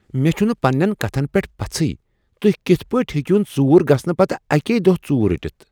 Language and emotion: Kashmiri, surprised